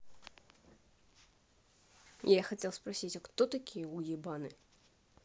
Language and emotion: Russian, neutral